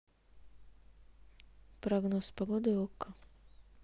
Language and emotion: Russian, neutral